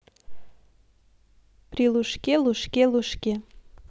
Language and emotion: Russian, positive